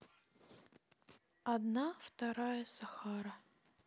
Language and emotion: Russian, neutral